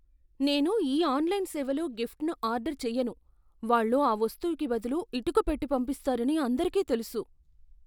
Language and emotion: Telugu, fearful